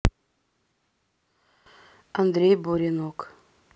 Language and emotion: Russian, neutral